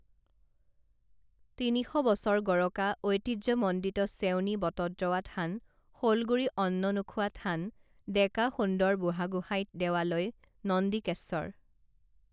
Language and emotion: Assamese, neutral